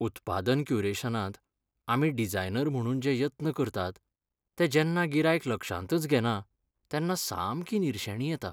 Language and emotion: Goan Konkani, sad